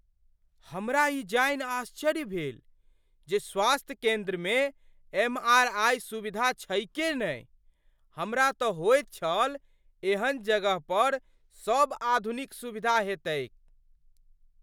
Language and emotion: Maithili, surprised